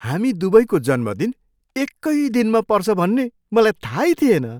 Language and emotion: Nepali, surprised